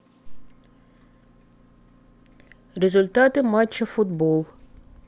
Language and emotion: Russian, neutral